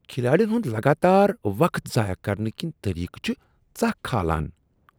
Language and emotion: Kashmiri, disgusted